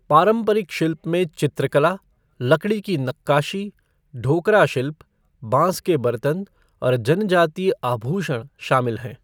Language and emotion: Hindi, neutral